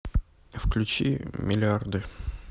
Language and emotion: Russian, neutral